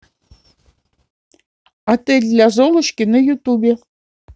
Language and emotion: Russian, neutral